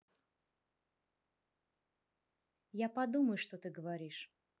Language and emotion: Russian, neutral